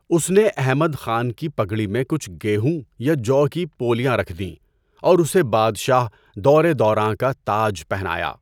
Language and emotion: Urdu, neutral